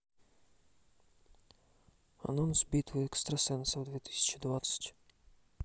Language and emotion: Russian, neutral